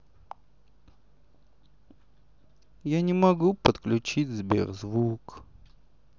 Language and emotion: Russian, sad